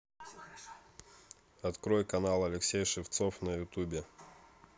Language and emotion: Russian, neutral